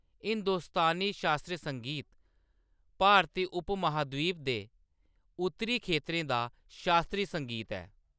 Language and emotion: Dogri, neutral